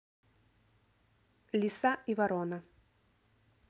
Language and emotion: Russian, neutral